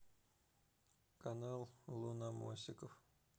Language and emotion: Russian, neutral